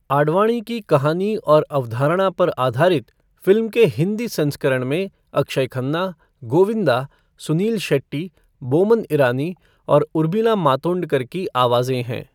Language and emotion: Hindi, neutral